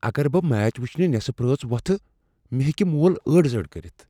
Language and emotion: Kashmiri, fearful